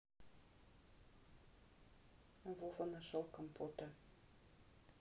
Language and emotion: Russian, neutral